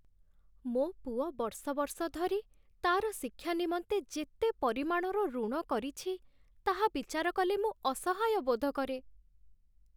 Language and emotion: Odia, sad